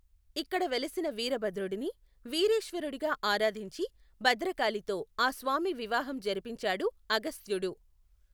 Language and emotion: Telugu, neutral